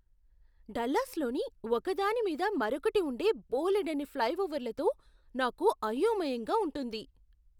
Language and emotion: Telugu, surprised